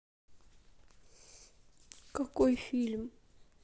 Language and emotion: Russian, sad